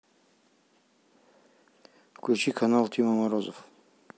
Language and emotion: Russian, neutral